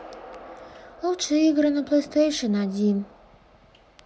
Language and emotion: Russian, sad